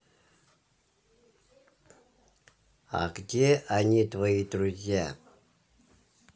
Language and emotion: Russian, neutral